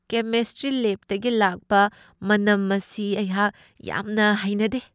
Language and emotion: Manipuri, disgusted